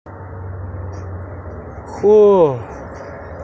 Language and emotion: Russian, neutral